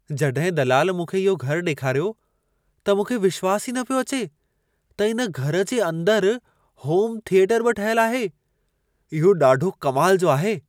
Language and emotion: Sindhi, surprised